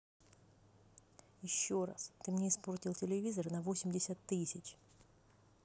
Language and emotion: Russian, angry